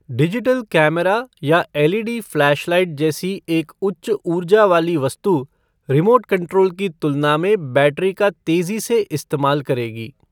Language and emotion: Hindi, neutral